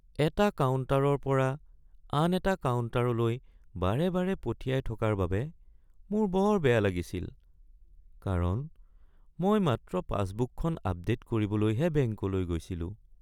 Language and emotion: Assamese, sad